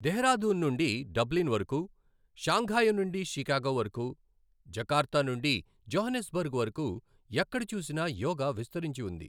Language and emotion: Telugu, neutral